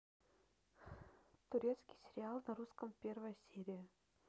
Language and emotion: Russian, neutral